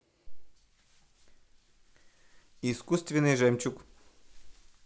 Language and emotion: Russian, neutral